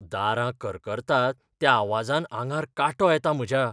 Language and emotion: Goan Konkani, fearful